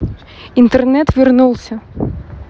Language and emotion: Russian, neutral